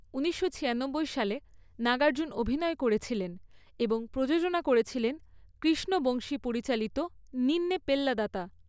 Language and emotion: Bengali, neutral